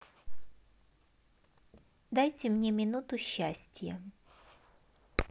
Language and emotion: Russian, positive